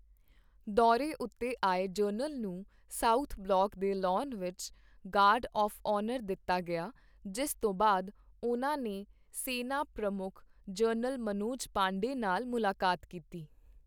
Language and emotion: Punjabi, neutral